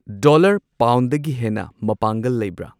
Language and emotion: Manipuri, neutral